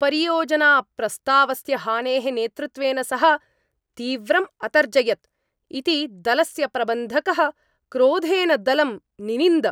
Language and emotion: Sanskrit, angry